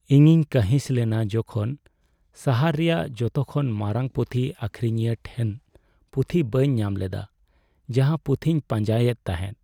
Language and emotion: Santali, sad